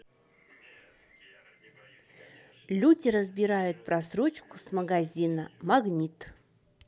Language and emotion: Russian, neutral